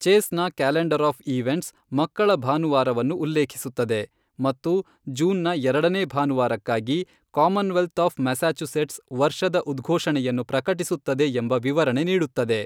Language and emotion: Kannada, neutral